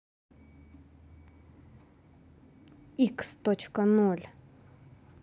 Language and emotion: Russian, angry